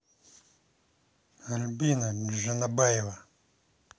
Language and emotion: Russian, angry